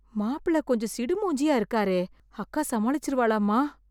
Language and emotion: Tamil, fearful